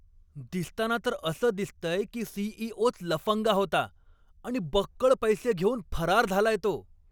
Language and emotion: Marathi, angry